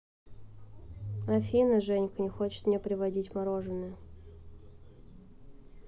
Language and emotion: Russian, neutral